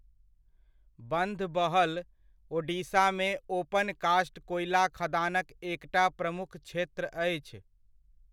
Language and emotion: Maithili, neutral